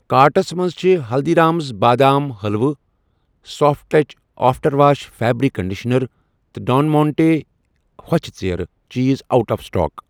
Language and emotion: Kashmiri, neutral